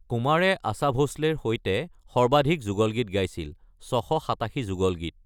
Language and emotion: Assamese, neutral